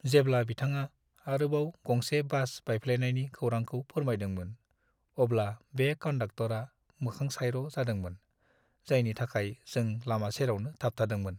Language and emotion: Bodo, sad